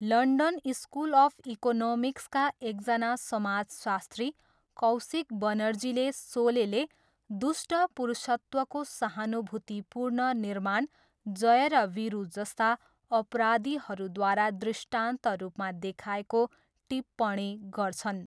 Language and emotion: Nepali, neutral